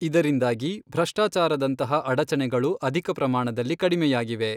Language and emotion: Kannada, neutral